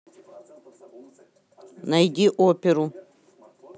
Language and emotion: Russian, neutral